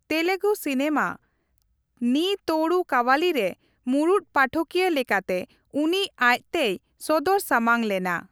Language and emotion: Santali, neutral